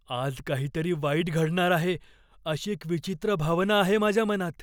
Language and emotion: Marathi, fearful